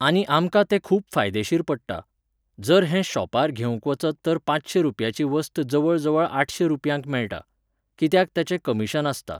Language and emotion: Goan Konkani, neutral